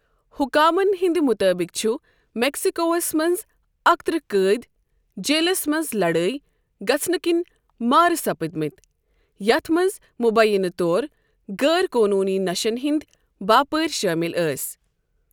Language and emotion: Kashmiri, neutral